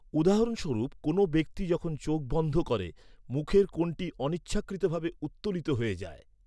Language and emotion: Bengali, neutral